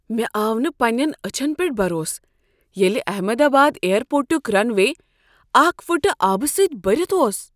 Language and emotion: Kashmiri, surprised